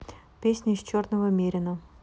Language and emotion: Russian, neutral